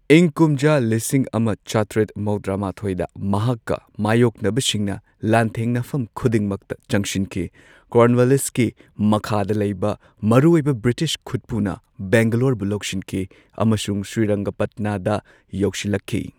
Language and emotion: Manipuri, neutral